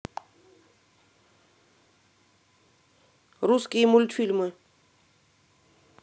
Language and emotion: Russian, neutral